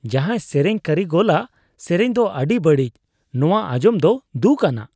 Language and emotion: Santali, disgusted